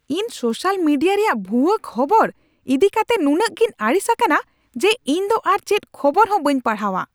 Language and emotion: Santali, angry